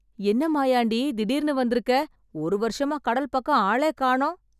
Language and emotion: Tamil, surprised